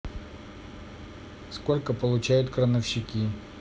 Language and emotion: Russian, neutral